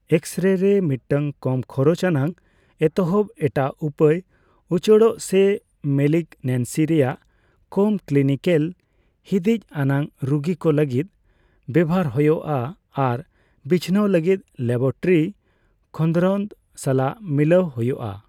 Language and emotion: Santali, neutral